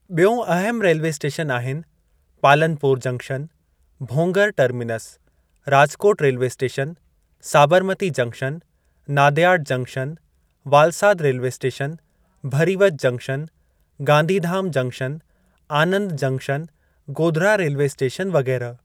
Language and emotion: Sindhi, neutral